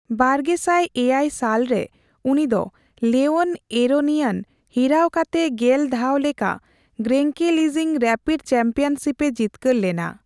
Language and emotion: Santali, neutral